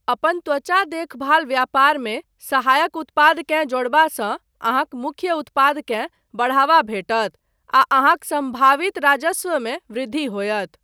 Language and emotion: Maithili, neutral